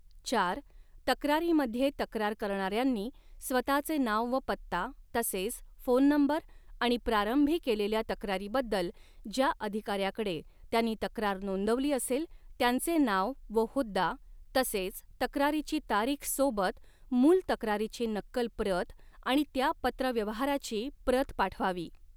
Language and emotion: Marathi, neutral